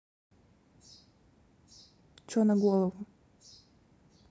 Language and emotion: Russian, angry